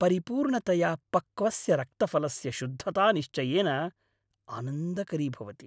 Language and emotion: Sanskrit, happy